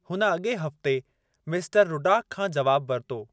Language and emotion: Sindhi, neutral